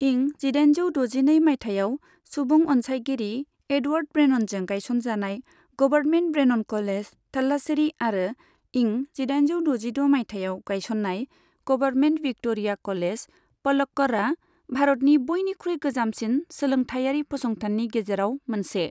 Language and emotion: Bodo, neutral